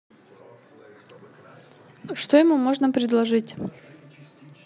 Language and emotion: Russian, neutral